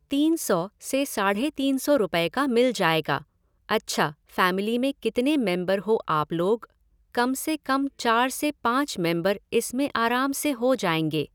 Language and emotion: Hindi, neutral